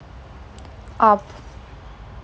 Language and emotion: Russian, neutral